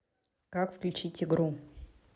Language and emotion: Russian, neutral